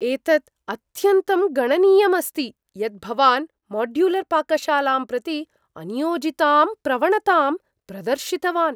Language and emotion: Sanskrit, surprised